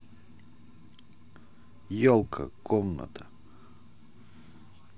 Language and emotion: Russian, neutral